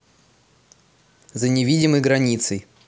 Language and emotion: Russian, neutral